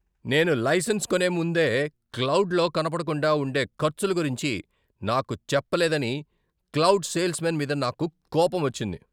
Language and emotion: Telugu, angry